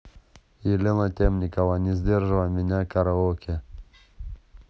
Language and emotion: Russian, neutral